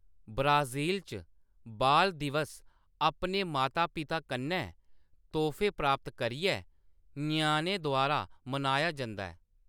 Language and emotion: Dogri, neutral